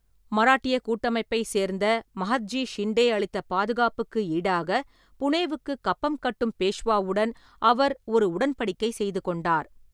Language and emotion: Tamil, neutral